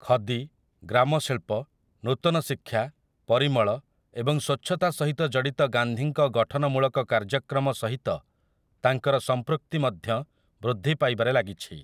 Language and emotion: Odia, neutral